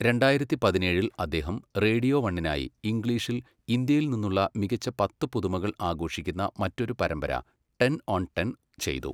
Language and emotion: Malayalam, neutral